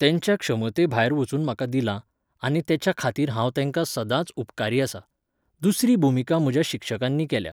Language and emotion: Goan Konkani, neutral